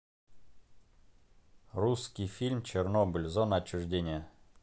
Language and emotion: Russian, neutral